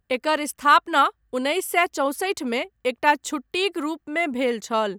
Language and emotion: Maithili, neutral